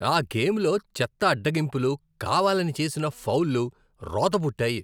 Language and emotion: Telugu, disgusted